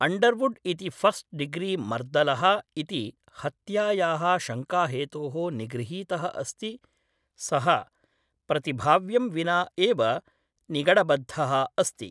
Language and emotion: Sanskrit, neutral